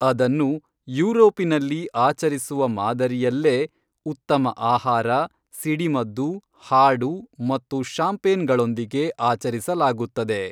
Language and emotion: Kannada, neutral